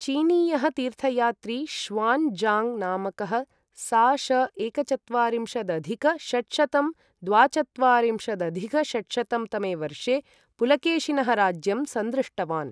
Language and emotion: Sanskrit, neutral